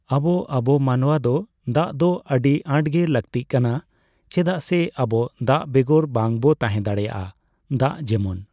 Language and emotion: Santali, neutral